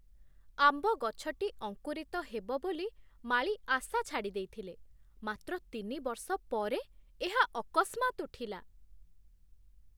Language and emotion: Odia, surprised